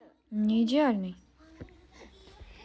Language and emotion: Russian, neutral